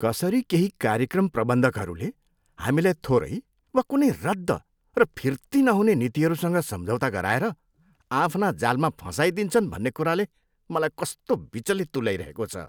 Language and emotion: Nepali, disgusted